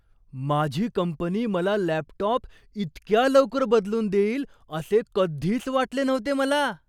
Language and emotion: Marathi, surprised